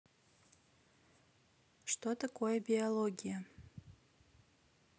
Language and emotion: Russian, neutral